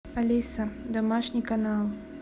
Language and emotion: Russian, neutral